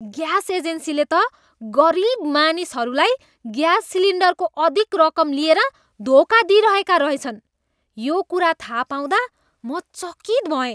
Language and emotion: Nepali, disgusted